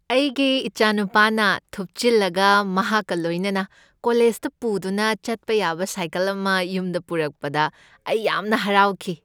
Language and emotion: Manipuri, happy